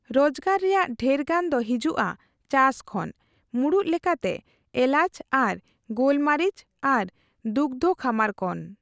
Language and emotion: Santali, neutral